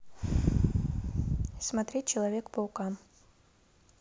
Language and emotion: Russian, neutral